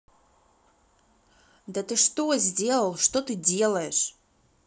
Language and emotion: Russian, angry